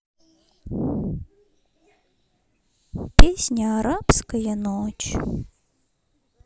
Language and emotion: Russian, sad